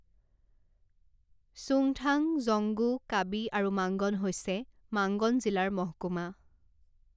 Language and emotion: Assamese, neutral